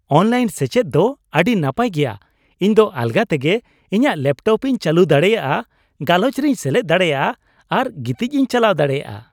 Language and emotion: Santali, happy